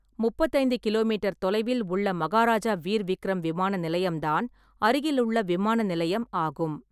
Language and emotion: Tamil, neutral